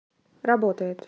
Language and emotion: Russian, neutral